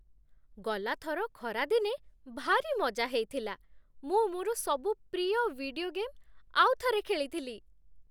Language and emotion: Odia, happy